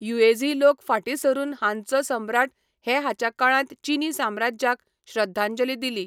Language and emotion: Goan Konkani, neutral